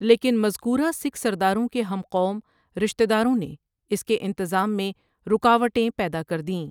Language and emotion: Urdu, neutral